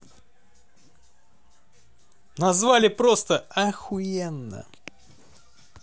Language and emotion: Russian, positive